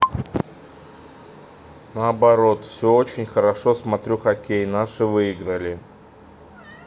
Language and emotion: Russian, neutral